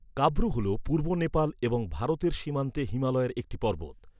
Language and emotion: Bengali, neutral